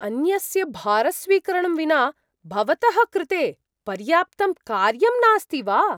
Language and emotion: Sanskrit, surprised